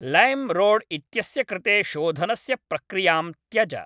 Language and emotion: Sanskrit, neutral